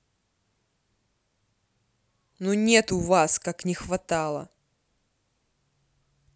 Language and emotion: Russian, angry